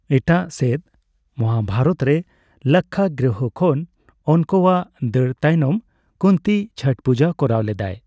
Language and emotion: Santali, neutral